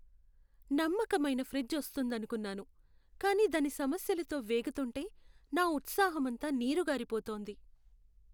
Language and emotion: Telugu, sad